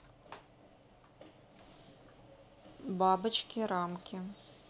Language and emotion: Russian, neutral